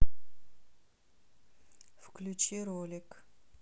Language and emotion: Russian, neutral